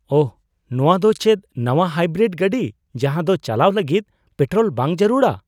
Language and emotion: Santali, surprised